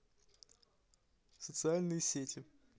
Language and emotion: Russian, neutral